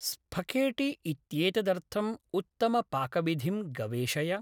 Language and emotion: Sanskrit, neutral